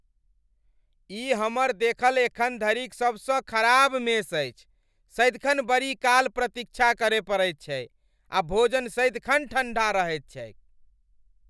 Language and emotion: Maithili, angry